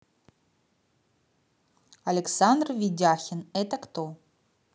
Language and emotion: Russian, neutral